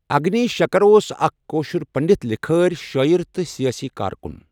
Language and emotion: Kashmiri, neutral